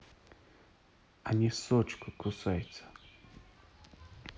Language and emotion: Russian, neutral